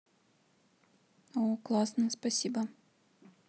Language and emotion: Russian, neutral